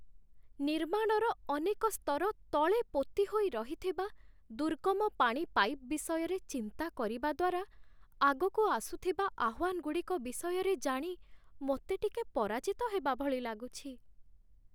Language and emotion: Odia, sad